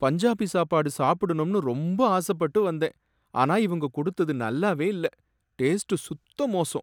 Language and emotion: Tamil, sad